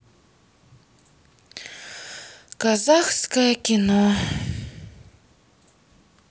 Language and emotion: Russian, sad